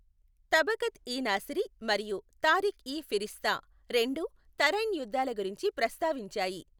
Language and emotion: Telugu, neutral